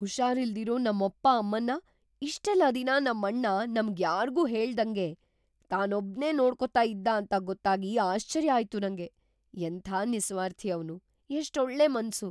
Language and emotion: Kannada, surprised